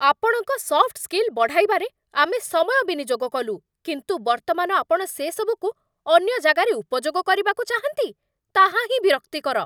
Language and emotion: Odia, angry